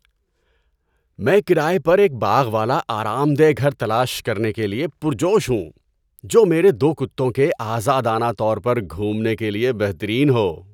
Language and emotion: Urdu, happy